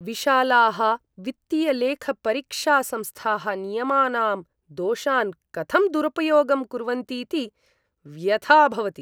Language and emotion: Sanskrit, disgusted